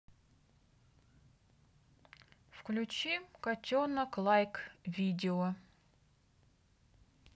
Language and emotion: Russian, neutral